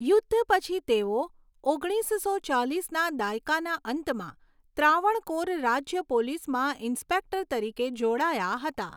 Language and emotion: Gujarati, neutral